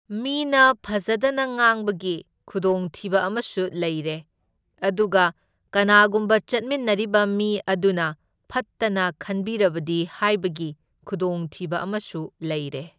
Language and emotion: Manipuri, neutral